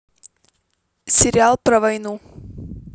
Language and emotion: Russian, neutral